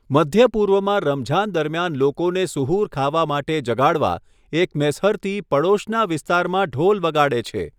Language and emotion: Gujarati, neutral